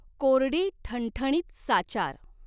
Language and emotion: Marathi, neutral